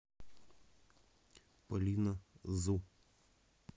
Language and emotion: Russian, neutral